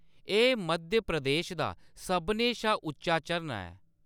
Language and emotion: Dogri, neutral